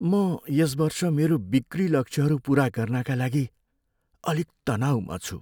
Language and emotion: Nepali, fearful